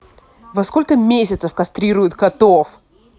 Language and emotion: Russian, angry